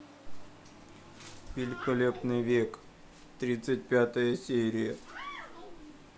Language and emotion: Russian, sad